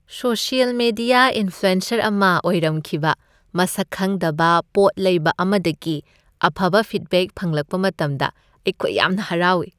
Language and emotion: Manipuri, happy